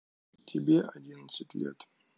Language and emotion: Russian, neutral